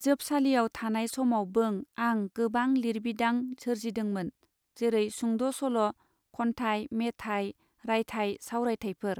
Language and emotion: Bodo, neutral